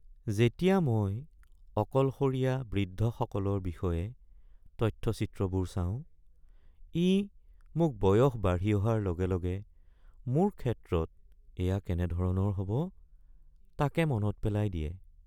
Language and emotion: Assamese, sad